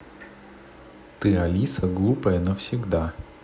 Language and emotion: Russian, neutral